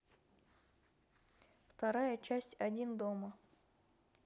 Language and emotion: Russian, neutral